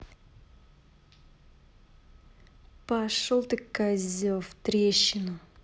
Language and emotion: Russian, angry